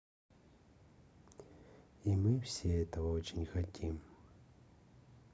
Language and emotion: Russian, neutral